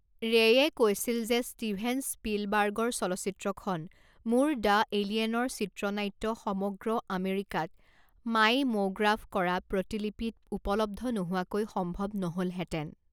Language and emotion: Assamese, neutral